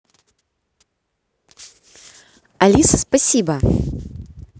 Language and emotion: Russian, positive